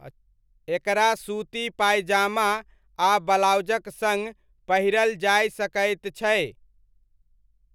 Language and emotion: Maithili, neutral